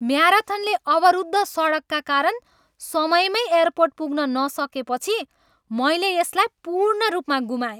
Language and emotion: Nepali, angry